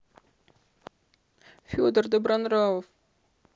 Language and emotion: Russian, sad